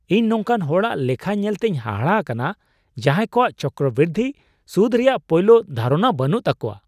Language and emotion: Santali, surprised